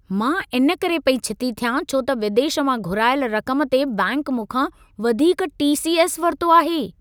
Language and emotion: Sindhi, angry